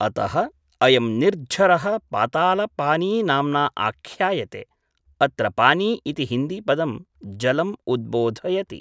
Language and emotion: Sanskrit, neutral